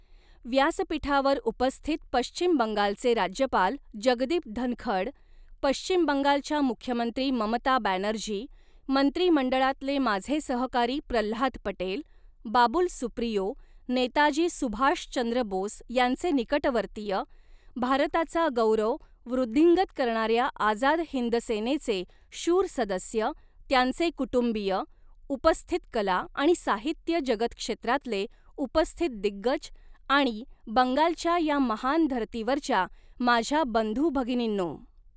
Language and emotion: Marathi, neutral